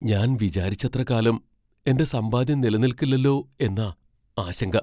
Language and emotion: Malayalam, fearful